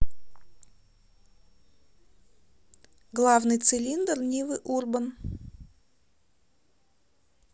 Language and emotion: Russian, neutral